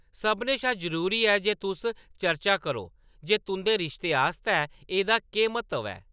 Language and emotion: Dogri, neutral